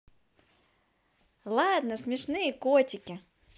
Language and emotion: Russian, positive